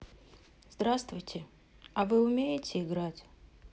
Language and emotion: Russian, sad